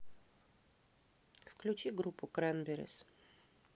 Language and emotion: Russian, neutral